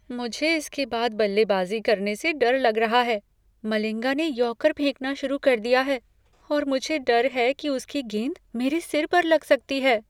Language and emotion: Hindi, fearful